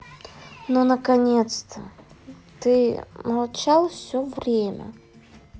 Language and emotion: Russian, sad